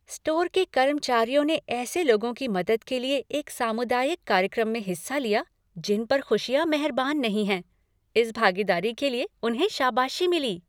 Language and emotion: Hindi, happy